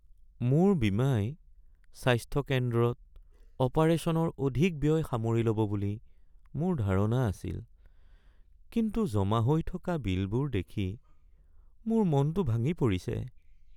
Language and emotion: Assamese, sad